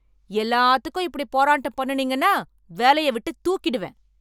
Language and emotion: Tamil, angry